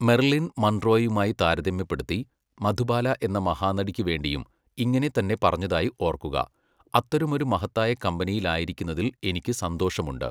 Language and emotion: Malayalam, neutral